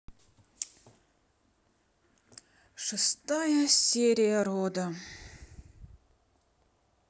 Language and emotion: Russian, sad